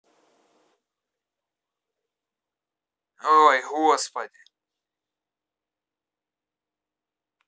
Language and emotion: Russian, angry